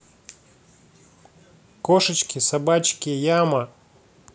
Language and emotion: Russian, neutral